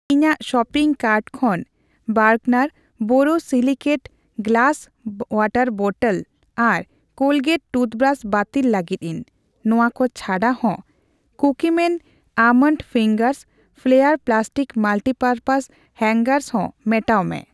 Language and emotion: Santali, neutral